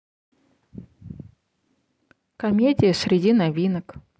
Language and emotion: Russian, neutral